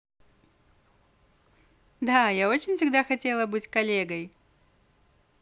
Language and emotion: Russian, positive